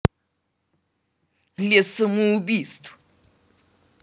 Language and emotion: Russian, angry